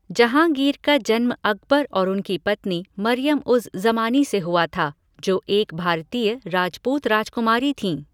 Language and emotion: Hindi, neutral